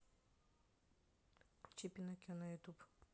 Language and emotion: Russian, neutral